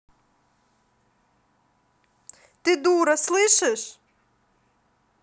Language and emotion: Russian, angry